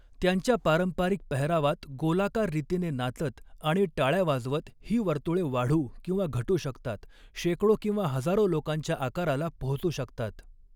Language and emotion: Marathi, neutral